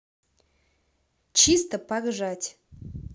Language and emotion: Russian, positive